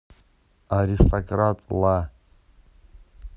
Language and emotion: Russian, neutral